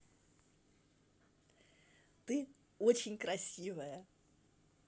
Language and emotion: Russian, positive